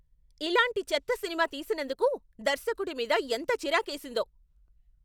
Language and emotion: Telugu, angry